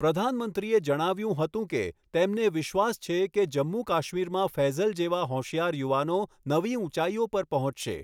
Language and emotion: Gujarati, neutral